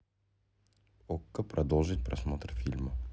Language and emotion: Russian, neutral